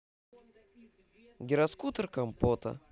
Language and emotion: Russian, neutral